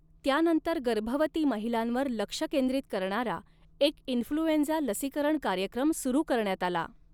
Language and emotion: Marathi, neutral